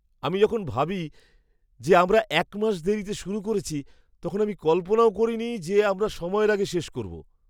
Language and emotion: Bengali, surprised